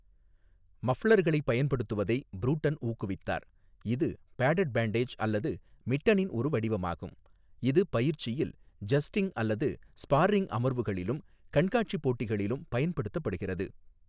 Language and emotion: Tamil, neutral